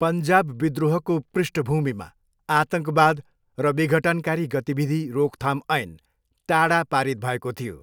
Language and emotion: Nepali, neutral